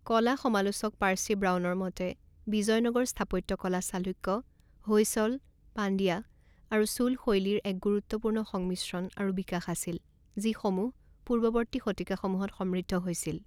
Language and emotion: Assamese, neutral